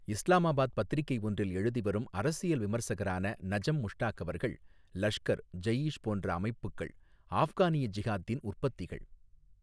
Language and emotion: Tamil, neutral